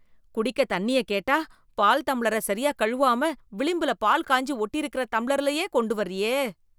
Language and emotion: Tamil, disgusted